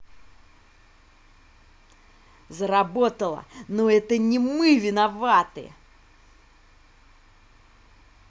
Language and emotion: Russian, angry